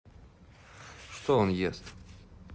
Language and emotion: Russian, neutral